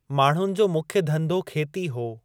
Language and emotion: Sindhi, neutral